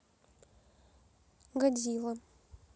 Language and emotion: Russian, neutral